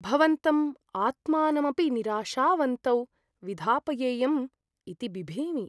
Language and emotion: Sanskrit, fearful